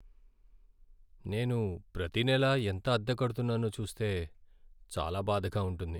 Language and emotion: Telugu, sad